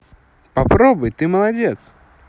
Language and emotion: Russian, positive